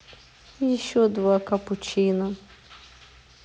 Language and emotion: Russian, neutral